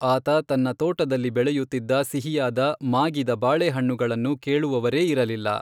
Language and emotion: Kannada, neutral